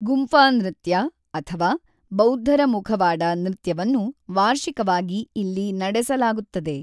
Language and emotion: Kannada, neutral